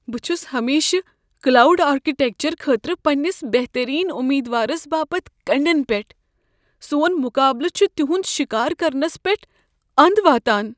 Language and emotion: Kashmiri, fearful